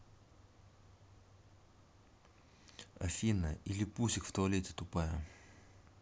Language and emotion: Russian, neutral